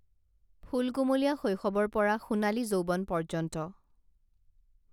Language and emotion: Assamese, neutral